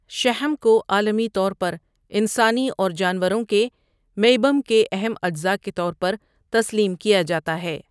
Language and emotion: Urdu, neutral